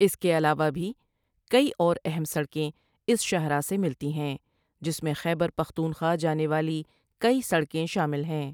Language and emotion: Urdu, neutral